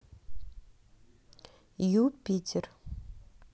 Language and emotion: Russian, neutral